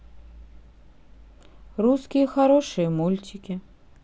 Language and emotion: Russian, sad